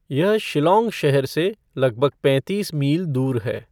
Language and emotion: Hindi, neutral